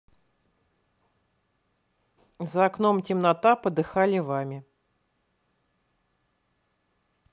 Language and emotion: Russian, neutral